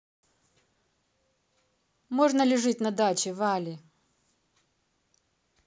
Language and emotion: Russian, angry